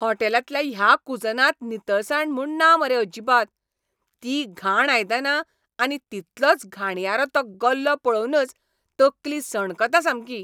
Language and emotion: Goan Konkani, angry